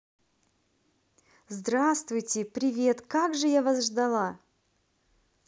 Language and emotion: Russian, positive